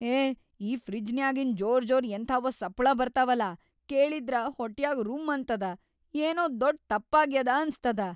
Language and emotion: Kannada, fearful